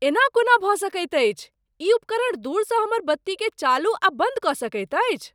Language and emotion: Maithili, surprised